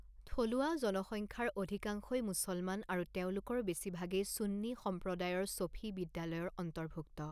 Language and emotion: Assamese, neutral